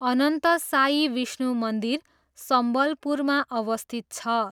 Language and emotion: Nepali, neutral